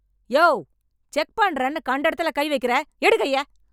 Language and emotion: Tamil, angry